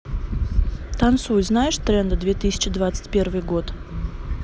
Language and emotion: Russian, neutral